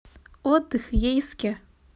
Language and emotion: Russian, neutral